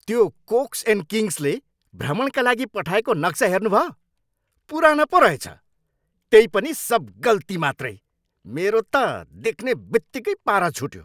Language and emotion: Nepali, angry